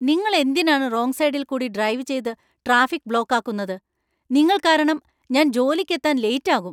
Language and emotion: Malayalam, angry